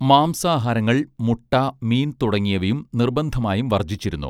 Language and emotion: Malayalam, neutral